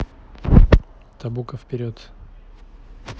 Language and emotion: Russian, neutral